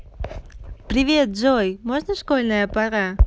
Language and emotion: Russian, positive